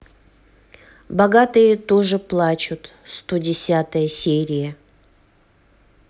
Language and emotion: Russian, neutral